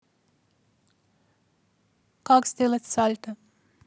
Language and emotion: Russian, neutral